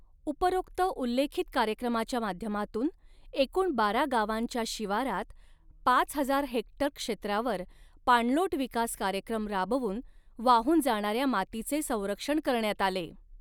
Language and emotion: Marathi, neutral